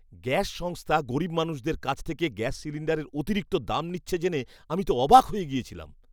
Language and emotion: Bengali, disgusted